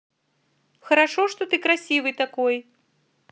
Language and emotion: Russian, positive